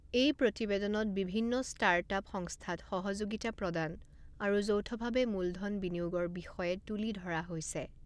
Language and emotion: Assamese, neutral